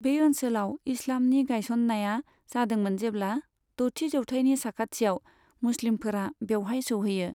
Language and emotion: Bodo, neutral